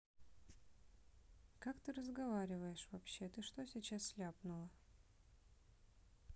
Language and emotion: Russian, neutral